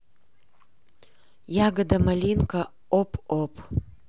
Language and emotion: Russian, neutral